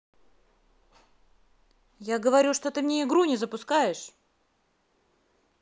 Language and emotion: Russian, angry